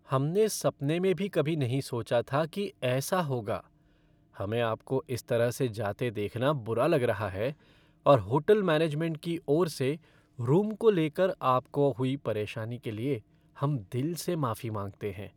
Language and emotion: Hindi, sad